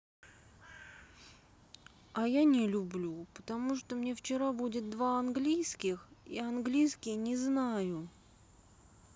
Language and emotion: Russian, sad